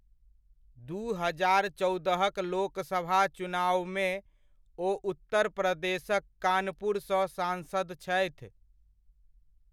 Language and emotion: Maithili, neutral